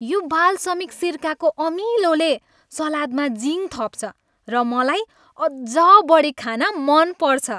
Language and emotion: Nepali, happy